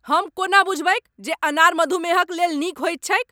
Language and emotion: Maithili, angry